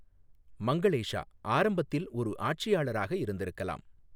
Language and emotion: Tamil, neutral